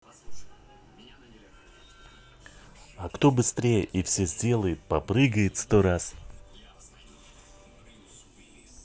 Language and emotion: Russian, neutral